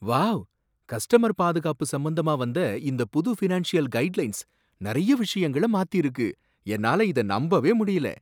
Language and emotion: Tamil, surprised